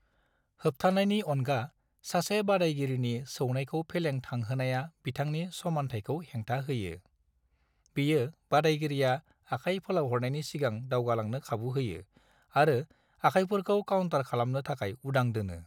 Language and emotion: Bodo, neutral